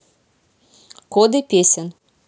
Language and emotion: Russian, neutral